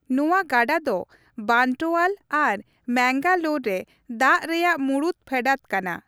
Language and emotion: Santali, neutral